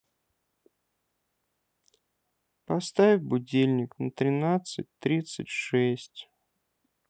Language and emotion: Russian, sad